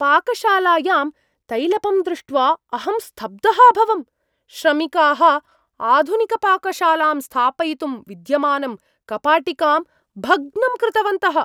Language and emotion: Sanskrit, surprised